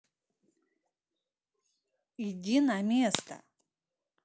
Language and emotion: Russian, angry